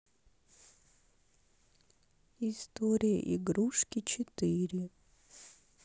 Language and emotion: Russian, sad